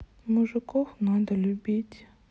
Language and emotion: Russian, sad